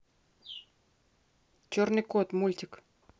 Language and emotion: Russian, neutral